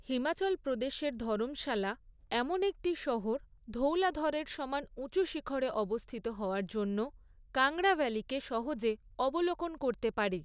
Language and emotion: Bengali, neutral